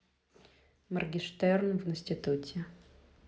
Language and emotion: Russian, neutral